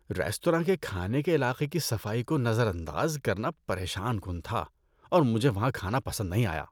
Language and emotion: Urdu, disgusted